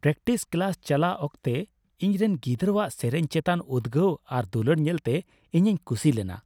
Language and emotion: Santali, happy